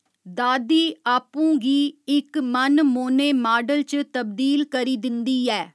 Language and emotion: Dogri, neutral